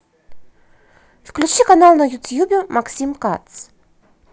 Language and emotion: Russian, positive